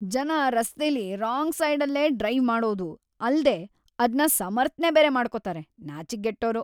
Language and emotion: Kannada, disgusted